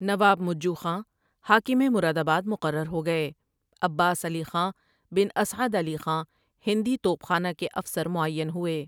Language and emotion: Urdu, neutral